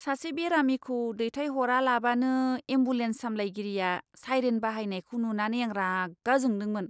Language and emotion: Bodo, disgusted